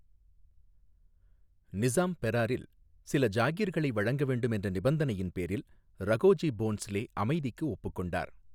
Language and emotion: Tamil, neutral